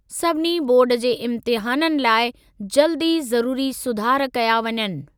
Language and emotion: Sindhi, neutral